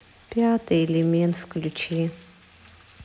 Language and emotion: Russian, sad